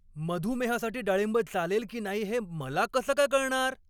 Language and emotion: Marathi, angry